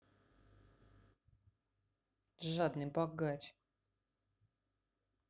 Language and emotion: Russian, angry